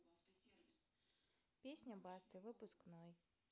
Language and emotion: Russian, neutral